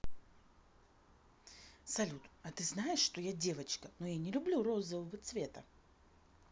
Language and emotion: Russian, neutral